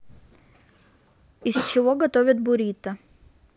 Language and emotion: Russian, neutral